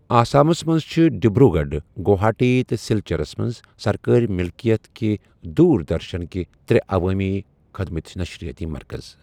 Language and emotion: Kashmiri, neutral